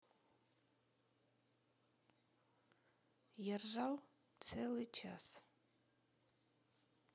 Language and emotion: Russian, sad